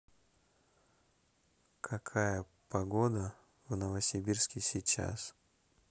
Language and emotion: Russian, neutral